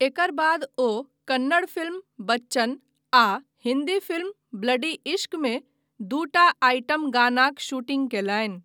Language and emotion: Maithili, neutral